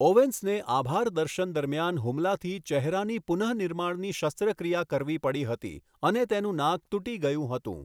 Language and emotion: Gujarati, neutral